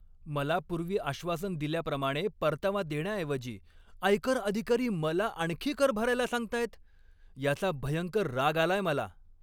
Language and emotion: Marathi, angry